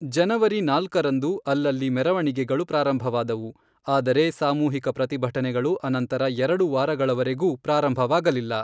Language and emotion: Kannada, neutral